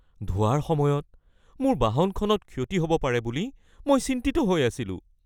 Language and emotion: Assamese, fearful